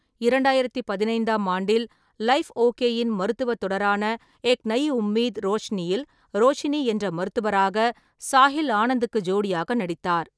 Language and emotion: Tamil, neutral